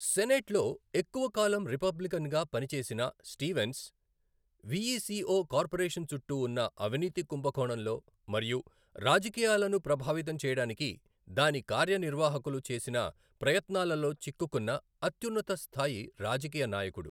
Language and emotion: Telugu, neutral